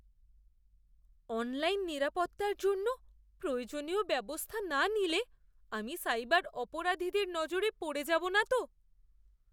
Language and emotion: Bengali, fearful